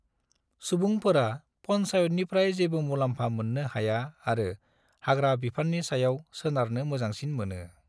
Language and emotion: Bodo, neutral